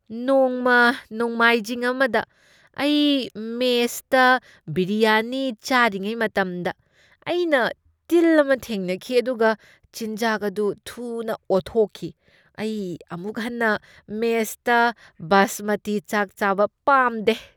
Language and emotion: Manipuri, disgusted